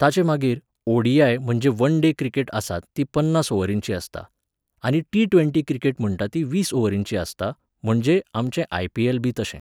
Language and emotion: Goan Konkani, neutral